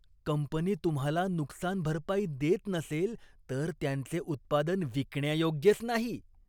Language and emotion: Marathi, disgusted